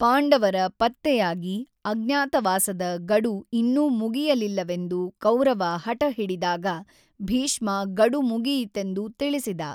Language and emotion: Kannada, neutral